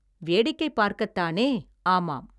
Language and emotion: Tamil, neutral